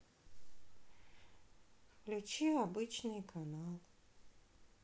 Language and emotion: Russian, sad